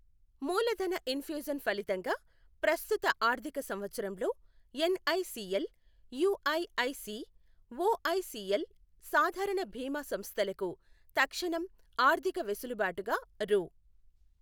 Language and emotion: Telugu, neutral